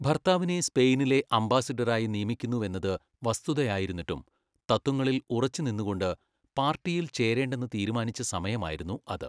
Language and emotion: Malayalam, neutral